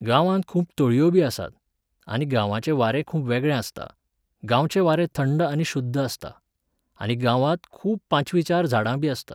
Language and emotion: Goan Konkani, neutral